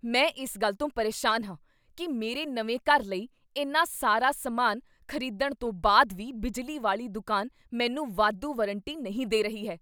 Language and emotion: Punjabi, angry